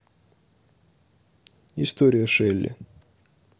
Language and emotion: Russian, neutral